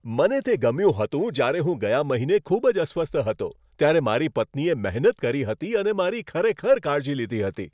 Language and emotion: Gujarati, happy